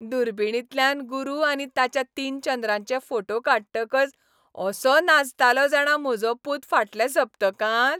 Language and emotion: Goan Konkani, happy